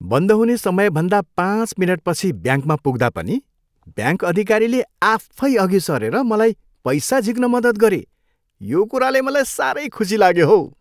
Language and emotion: Nepali, happy